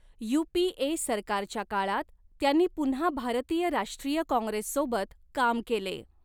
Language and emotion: Marathi, neutral